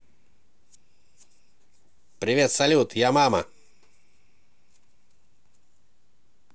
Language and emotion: Russian, positive